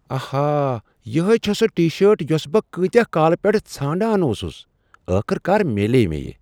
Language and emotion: Kashmiri, surprised